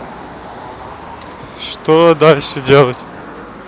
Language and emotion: Russian, neutral